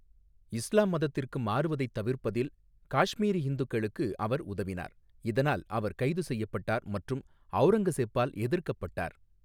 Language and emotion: Tamil, neutral